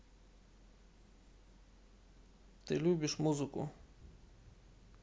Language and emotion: Russian, neutral